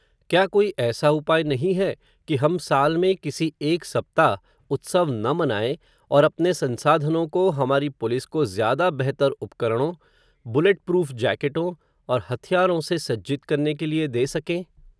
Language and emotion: Hindi, neutral